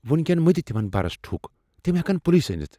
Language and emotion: Kashmiri, fearful